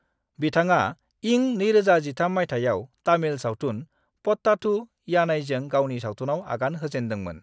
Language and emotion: Bodo, neutral